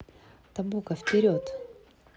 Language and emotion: Russian, neutral